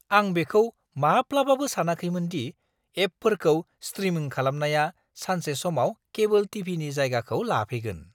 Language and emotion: Bodo, surprised